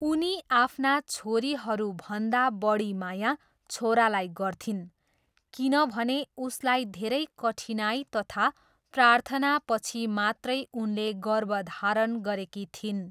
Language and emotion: Nepali, neutral